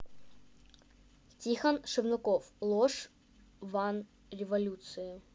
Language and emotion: Russian, neutral